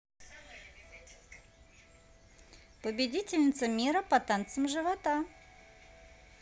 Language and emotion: Russian, positive